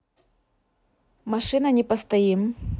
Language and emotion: Russian, neutral